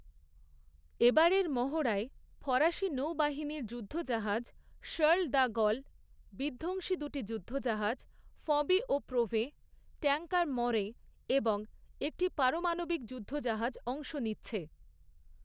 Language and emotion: Bengali, neutral